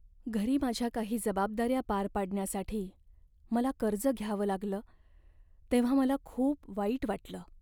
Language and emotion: Marathi, sad